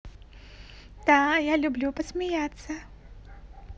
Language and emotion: Russian, positive